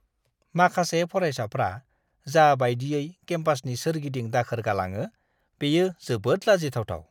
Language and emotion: Bodo, disgusted